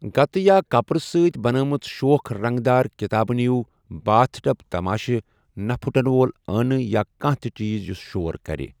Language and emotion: Kashmiri, neutral